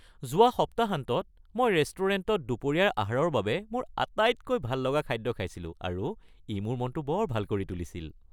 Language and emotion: Assamese, happy